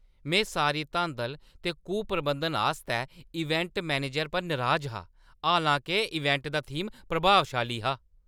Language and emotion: Dogri, angry